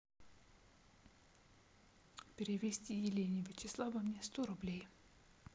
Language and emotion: Russian, neutral